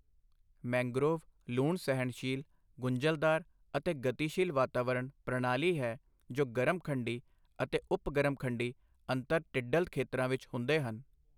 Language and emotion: Punjabi, neutral